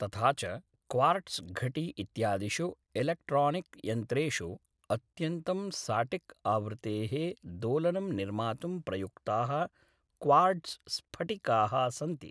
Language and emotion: Sanskrit, neutral